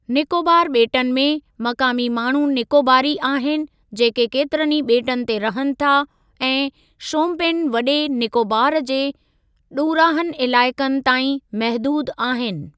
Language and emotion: Sindhi, neutral